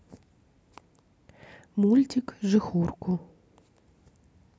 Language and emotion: Russian, neutral